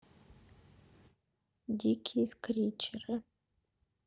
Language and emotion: Russian, sad